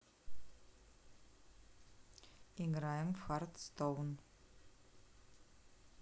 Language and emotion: Russian, neutral